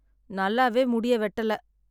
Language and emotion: Tamil, sad